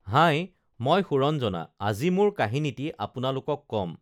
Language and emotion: Assamese, neutral